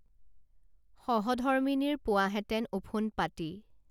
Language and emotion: Assamese, neutral